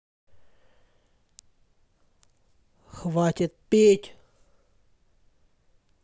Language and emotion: Russian, angry